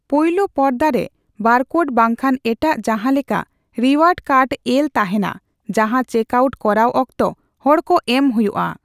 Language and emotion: Santali, neutral